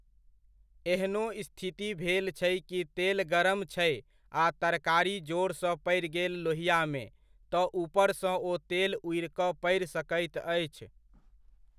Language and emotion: Maithili, neutral